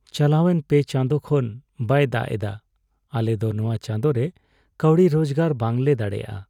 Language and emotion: Santali, sad